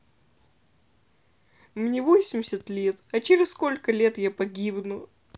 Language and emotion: Russian, sad